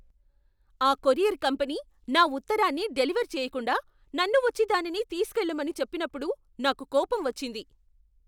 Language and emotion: Telugu, angry